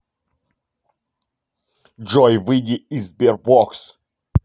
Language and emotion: Russian, angry